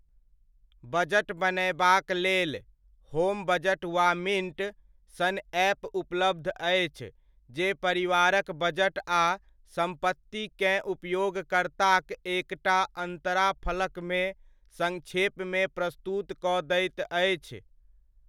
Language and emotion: Maithili, neutral